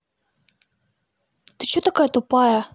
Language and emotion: Russian, angry